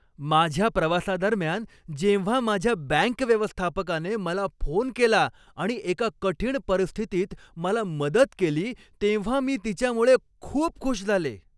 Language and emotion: Marathi, happy